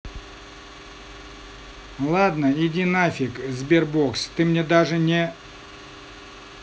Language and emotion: Russian, neutral